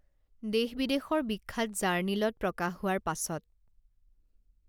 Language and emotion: Assamese, neutral